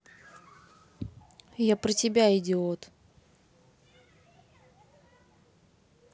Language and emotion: Russian, neutral